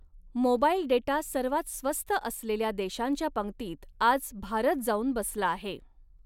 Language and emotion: Marathi, neutral